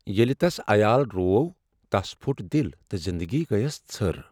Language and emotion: Kashmiri, sad